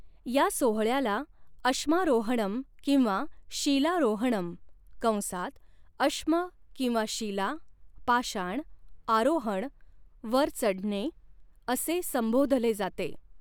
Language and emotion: Marathi, neutral